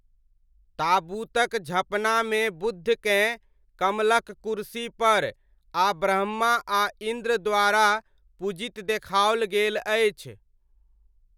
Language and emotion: Maithili, neutral